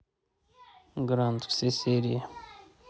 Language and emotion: Russian, neutral